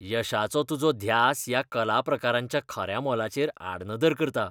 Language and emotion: Goan Konkani, disgusted